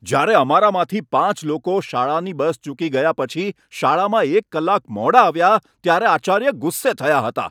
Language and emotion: Gujarati, angry